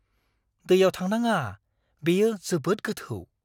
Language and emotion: Bodo, fearful